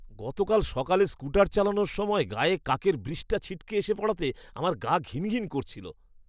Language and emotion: Bengali, disgusted